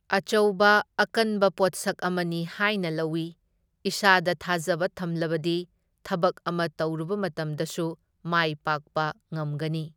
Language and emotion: Manipuri, neutral